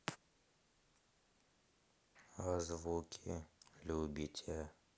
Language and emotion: Russian, sad